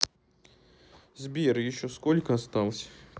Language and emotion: Russian, sad